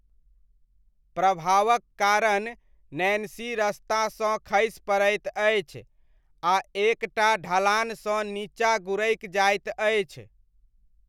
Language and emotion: Maithili, neutral